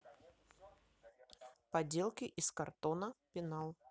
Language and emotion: Russian, neutral